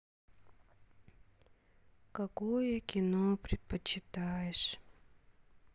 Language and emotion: Russian, sad